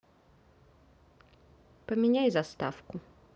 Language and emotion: Russian, neutral